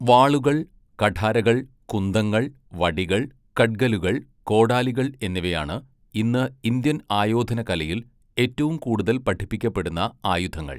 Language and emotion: Malayalam, neutral